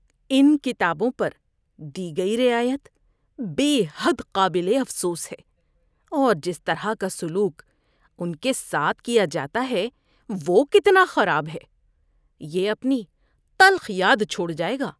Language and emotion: Urdu, disgusted